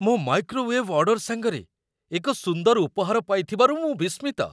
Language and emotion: Odia, surprised